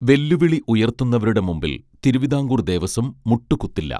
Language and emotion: Malayalam, neutral